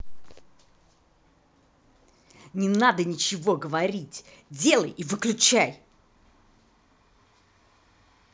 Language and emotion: Russian, angry